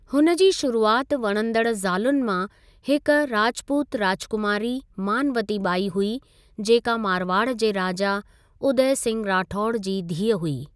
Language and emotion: Sindhi, neutral